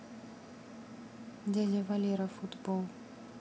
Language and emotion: Russian, neutral